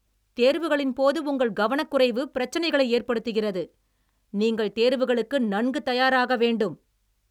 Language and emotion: Tamil, angry